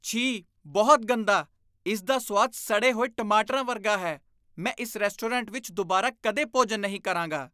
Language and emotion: Punjabi, disgusted